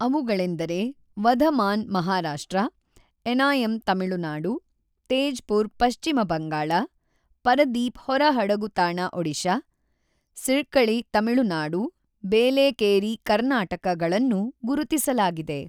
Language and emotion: Kannada, neutral